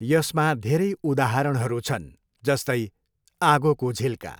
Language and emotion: Nepali, neutral